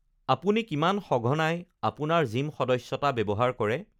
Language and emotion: Assamese, neutral